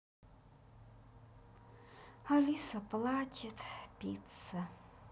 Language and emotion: Russian, sad